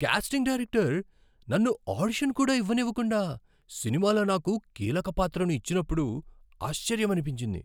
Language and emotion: Telugu, surprised